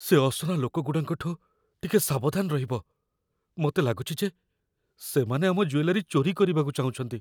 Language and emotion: Odia, fearful